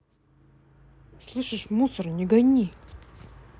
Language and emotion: Russian, angry